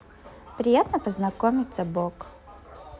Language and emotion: Russian, positive